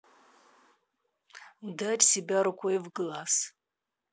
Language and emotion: Russian, angry